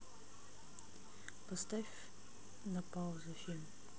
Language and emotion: Russian, neutral